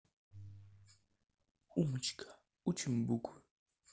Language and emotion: Russian, neutral